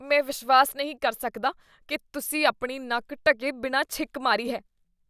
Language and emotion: Punjabi, disgusted